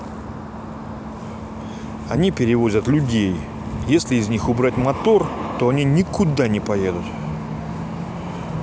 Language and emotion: Russian, angry